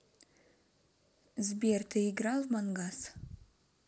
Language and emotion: Russian, neutral